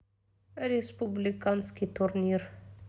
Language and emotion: Russian, neutral